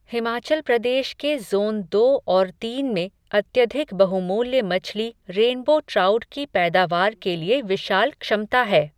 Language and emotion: Hindi, neutral